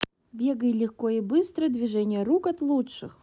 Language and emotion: Russian, neutral